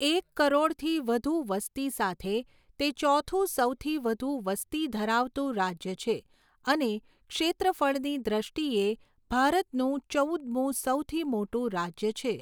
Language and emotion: Gujarati, neutral